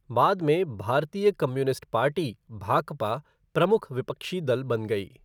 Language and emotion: Hindi, neutral